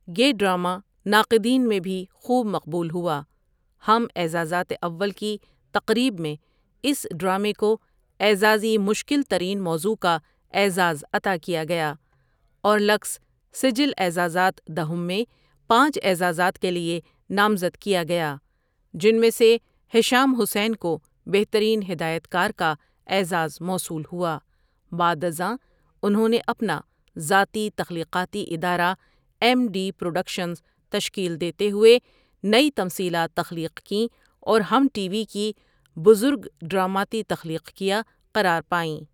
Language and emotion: Urdu, neutral